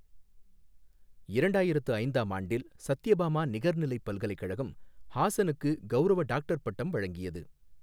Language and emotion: Tamil, neutral